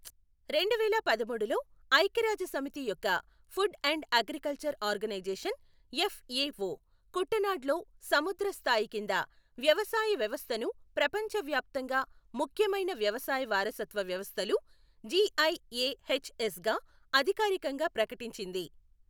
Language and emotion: Telugu, neutral